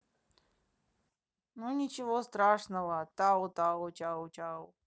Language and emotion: Russian, neutral